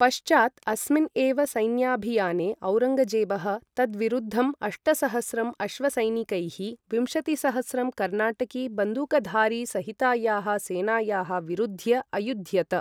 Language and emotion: Sanskrit, neutral